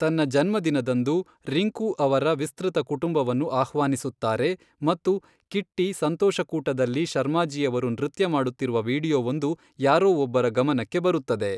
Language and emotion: Kannada, neutral